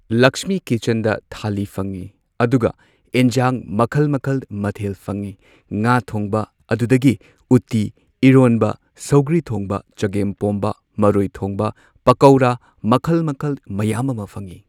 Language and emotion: Manipuri, neutral